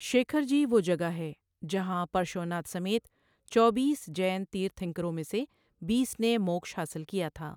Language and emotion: Urdu, neutral